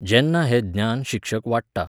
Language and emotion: Goan Konkani, neutral